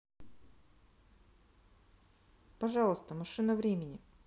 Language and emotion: Russian, neutral